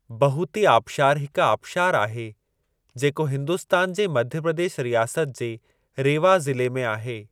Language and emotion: Sindhi, neutral